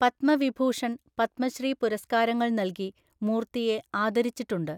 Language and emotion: Malayalam, neutral